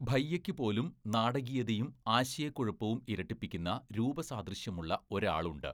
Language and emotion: Malayalam, neutral